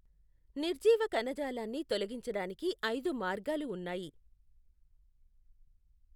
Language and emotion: Telugu, neutral